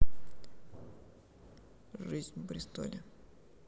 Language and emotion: Russian, sad